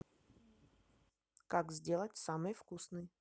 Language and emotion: Russian, neutral